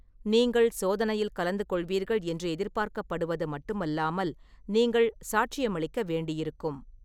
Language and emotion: Tamil, neutral